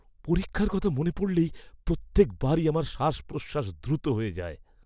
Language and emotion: Bengali, fearful